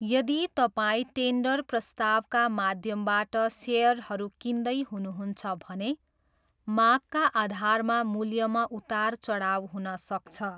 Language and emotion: Nepali, neutral